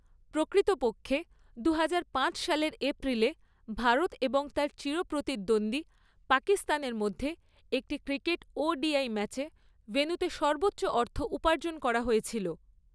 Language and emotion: Bengali, neutral